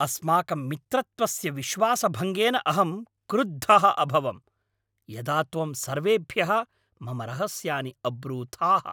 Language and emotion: Sanskrit, angry